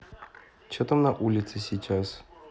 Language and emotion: Russian, neutral